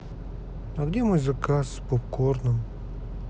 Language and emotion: Russian, sad